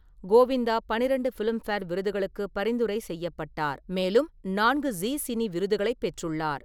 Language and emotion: Tamil, neutral